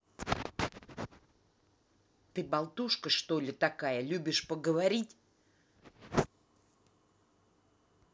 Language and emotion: Russian, angry